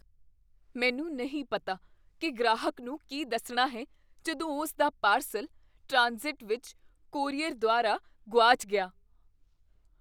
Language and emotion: Punjabi, fearful